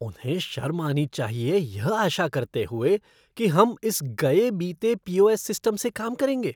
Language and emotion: Hindi, disgusted